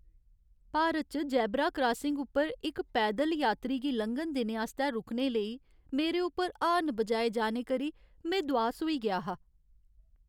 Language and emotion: Dogri, sad